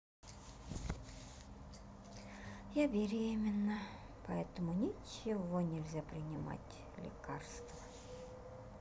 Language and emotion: Russian, sad